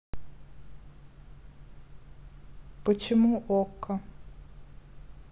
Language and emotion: Russian, neutral